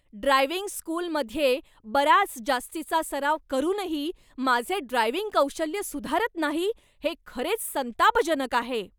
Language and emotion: Marathi, angry